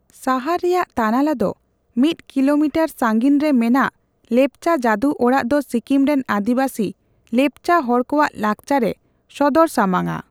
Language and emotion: Santali, neutral